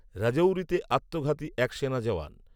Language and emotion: Bengali, neutral